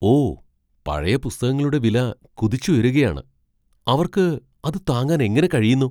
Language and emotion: Malayalam, surprised